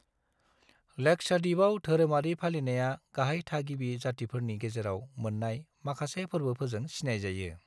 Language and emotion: Bodo, neutral